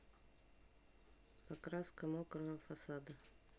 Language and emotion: Russian, neutral